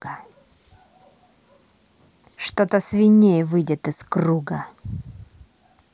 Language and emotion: Russian, angry